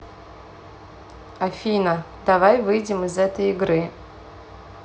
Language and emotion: Russian, neutral